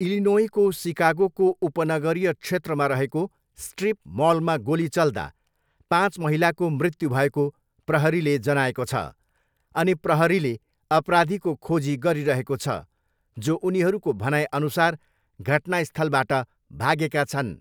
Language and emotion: Nepali, neutral